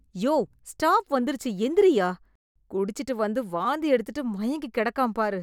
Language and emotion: Tamil, disgusted